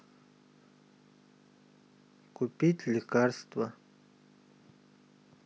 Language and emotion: Russian, neutral